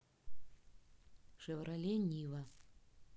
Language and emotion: Russian, neutral